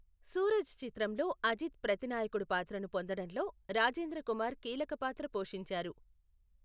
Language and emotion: Telugu, neutral